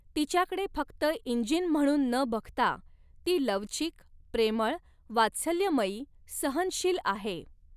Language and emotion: Marathi, neutral